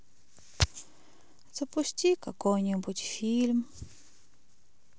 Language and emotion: Russian, sad